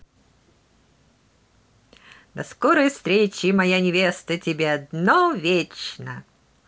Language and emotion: Russian, positive